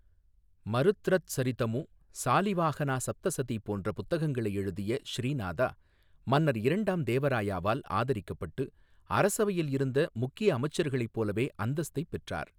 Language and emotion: Tamil, neutral